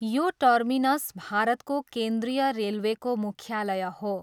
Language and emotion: Nepali, neutral